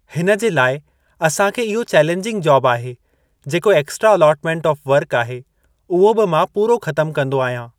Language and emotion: Sindhi, neutral